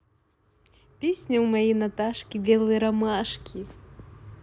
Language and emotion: Russian, positive